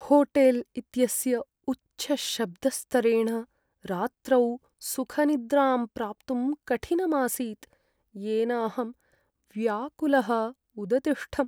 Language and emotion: Sanskrit, sad